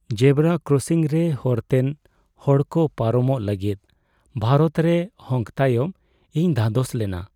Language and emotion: Santali, sad